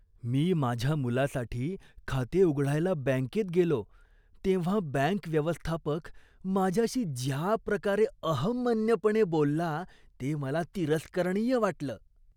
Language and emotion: Marathi, disgusted